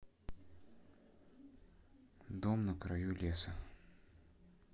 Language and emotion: Russian, neutral